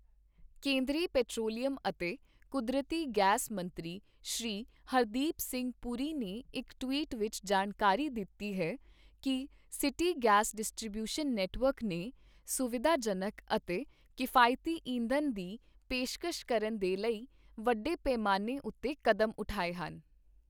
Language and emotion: Punjabi, neutral